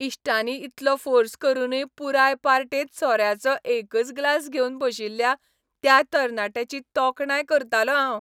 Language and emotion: Goan Konkani, happy